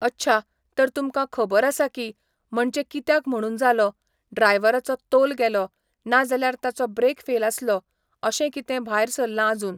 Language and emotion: Goan Konkani, neutral